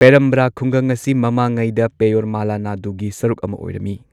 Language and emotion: Manipuri, neutral